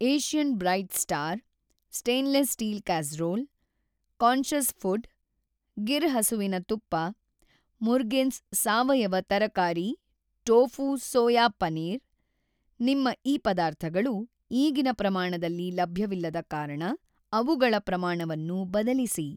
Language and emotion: Kannada, neutral